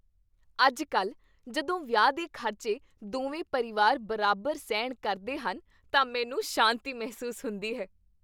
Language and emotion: Punjabi, happy